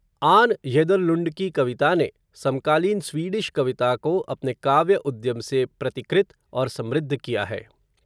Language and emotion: Hindi, neutral